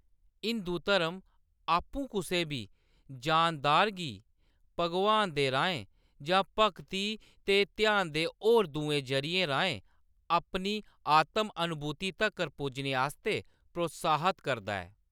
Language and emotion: Dogri, neutral